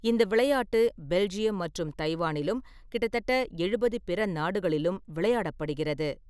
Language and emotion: Tamil, neutral